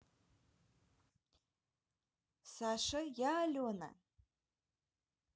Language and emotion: Russian, neutral